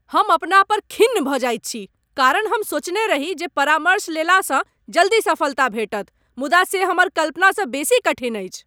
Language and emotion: Maithili, angry